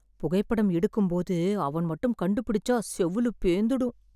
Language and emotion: Tamil, fearful